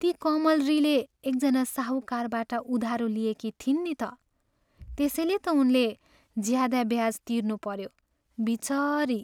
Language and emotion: Nepali, sad